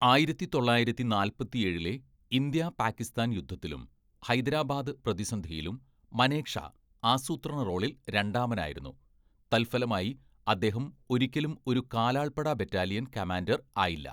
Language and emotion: Malayalam, neutral